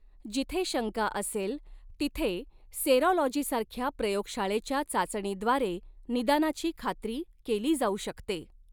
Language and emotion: Marathi, neutral